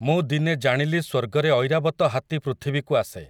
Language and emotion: Odia, neutral